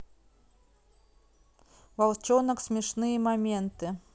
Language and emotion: Russian, neutral